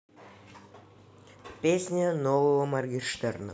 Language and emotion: Russian, neutral